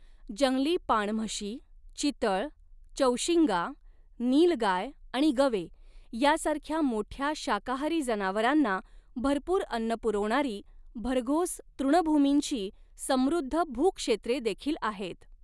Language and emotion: Marathi, neutral